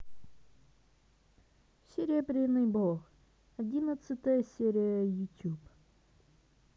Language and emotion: Russian, neutral